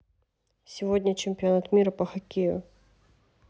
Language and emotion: Russian, neutral